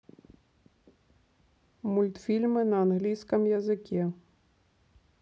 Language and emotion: Russian, neutral